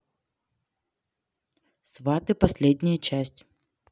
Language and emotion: Russian, neutral